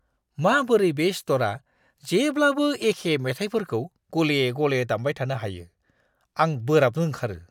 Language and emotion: Bodo, disgusted